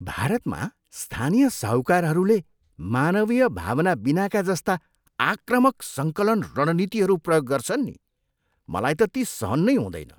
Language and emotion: Nepali, disgusted